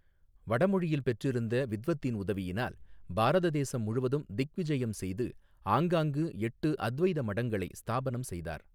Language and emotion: Tamil, neutral